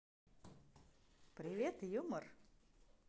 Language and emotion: Russian, positive